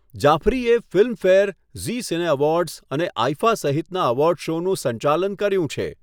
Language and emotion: Gujarati, neutral